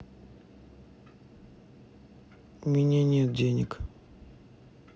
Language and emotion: Russian, sad